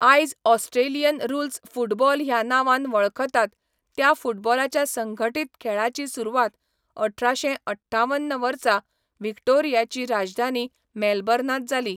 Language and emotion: Goan Konkani, neutral